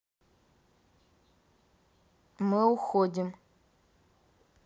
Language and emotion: Russian, neutral